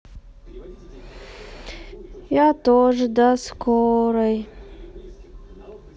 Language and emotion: Russian, sad